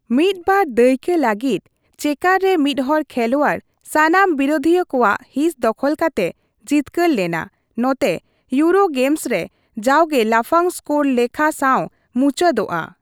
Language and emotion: Santali, neutral